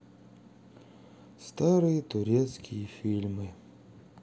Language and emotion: Russian, sad